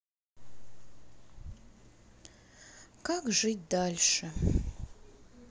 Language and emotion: Russian, sad